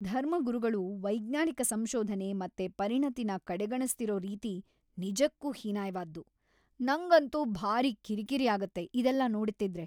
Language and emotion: Kannada, angry